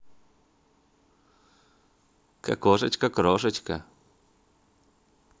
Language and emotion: Russian, neutral